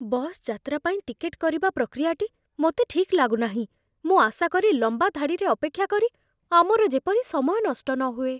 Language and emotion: Odia, fearful